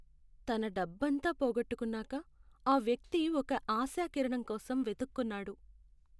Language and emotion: Telugu, sad